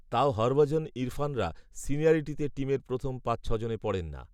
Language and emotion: Bengali, neutral